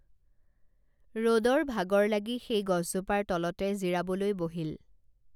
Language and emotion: Assamese, neutral